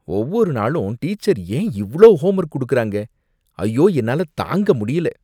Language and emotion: Tamil, disgusted